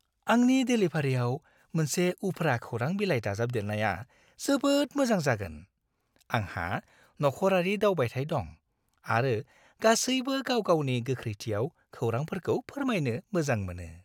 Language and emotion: Bodo, happy